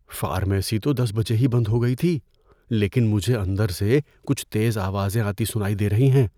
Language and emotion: Urdu, fearful